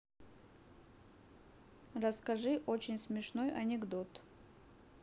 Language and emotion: Russian, neutral